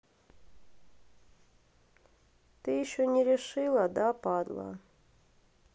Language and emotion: Russian, sad